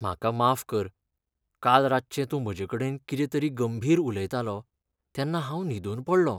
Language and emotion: Goan Konkani, sad